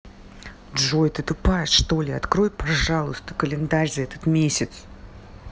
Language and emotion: Russian, angry